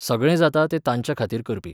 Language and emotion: Goan Konkani, neutral